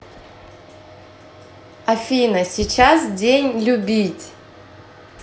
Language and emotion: Russian, positive